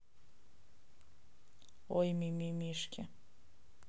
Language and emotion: Russian, neutral